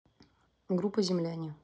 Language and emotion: Russian, neutral